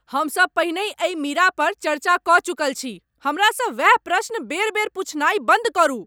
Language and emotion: Maithili, angry